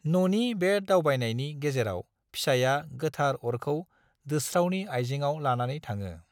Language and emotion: Bodo, neutral